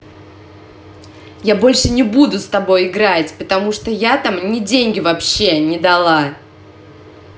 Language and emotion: Russian, angry